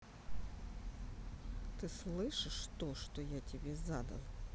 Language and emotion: Russian, angry